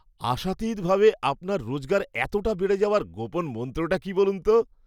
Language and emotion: Bengali, surprised